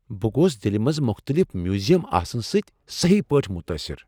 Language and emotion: Kashmiri, surprised